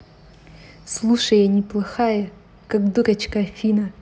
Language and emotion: Russian, neutral